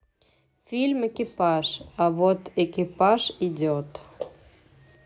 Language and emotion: Russian, neutral